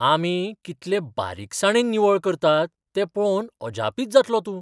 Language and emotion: Goan Konkani, surprised